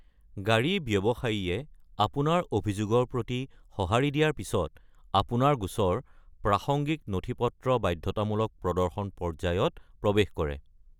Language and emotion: Assamese, neutral